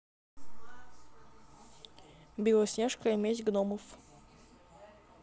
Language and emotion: Russian, neutral